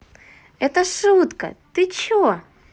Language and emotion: Russian, positive